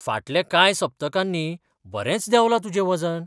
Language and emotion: Goan Konkani, surprised